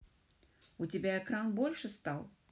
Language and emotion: Russian, neutral